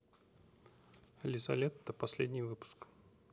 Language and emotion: Russian, neutral